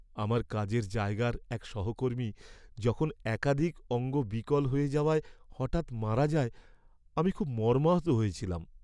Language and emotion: Bengali, sad